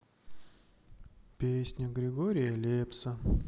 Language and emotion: Russian, sad